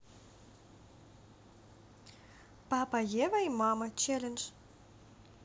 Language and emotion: Russian, positive